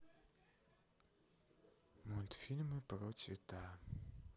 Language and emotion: Russian, neutral